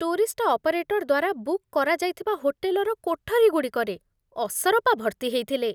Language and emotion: Odia, disgusted